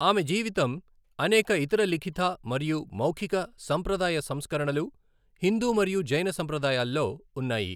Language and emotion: Telugu, neutral